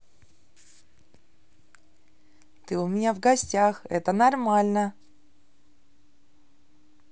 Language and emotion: Russian, positive